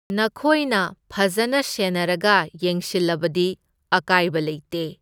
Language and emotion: Manipuri, neutral